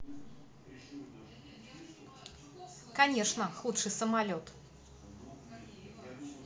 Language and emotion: Russian, neutral